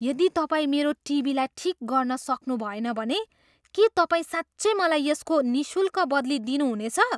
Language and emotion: Nepali, surprised